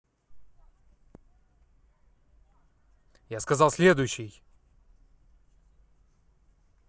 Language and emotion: Russian, angry